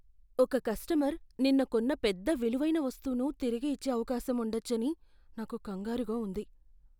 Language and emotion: Telugu, fearful